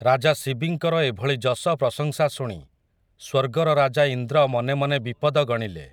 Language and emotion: Odia, neutral